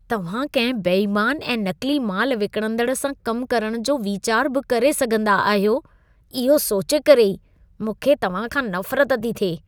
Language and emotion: Sindhi, disgusted